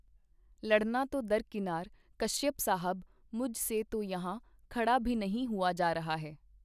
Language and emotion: Punjabi, neutral